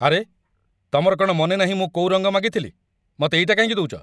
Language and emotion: Odia, angry